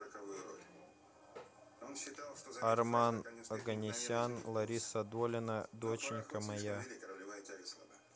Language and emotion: Russian, neutral